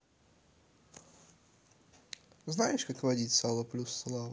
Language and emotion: Russian, neutral